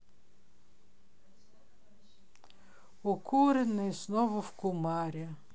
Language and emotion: Russian, neutral